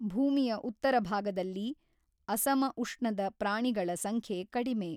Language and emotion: Kannada, neutral